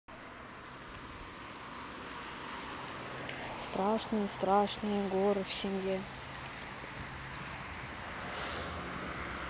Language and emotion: Russian, neutral